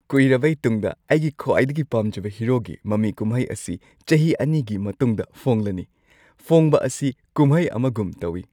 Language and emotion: Manipuri, happy